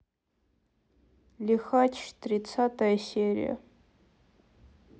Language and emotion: Russian, sad